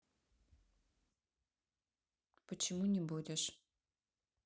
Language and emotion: Russian, neutral